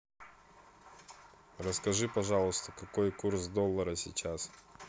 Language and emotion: Russian, neutral